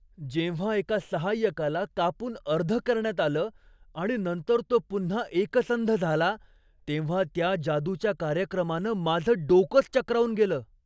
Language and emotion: Marathi, surprised